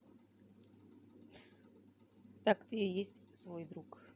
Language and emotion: Russian, neutral